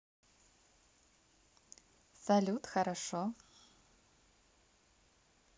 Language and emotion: Russian, positive